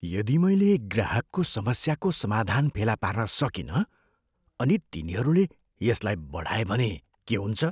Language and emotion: Nepali, fearful